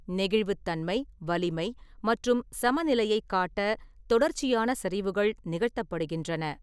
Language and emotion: Tamil, neutral